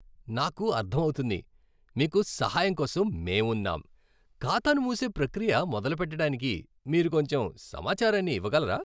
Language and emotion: Telugu, happy